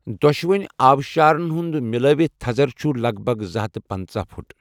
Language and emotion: Kashmiri, neutral